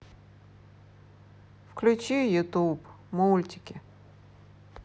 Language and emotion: Russian, neutral